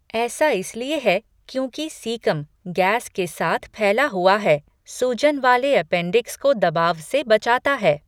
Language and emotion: Hindi, neutral